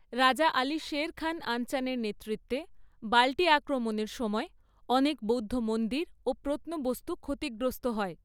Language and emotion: Bengali, neutral